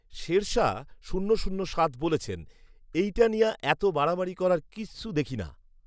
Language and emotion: Bengali, neutral